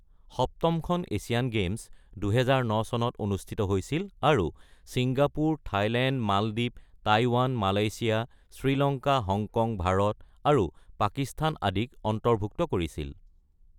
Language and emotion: Assamese, neutral